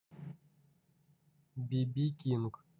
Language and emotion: Russian, neutral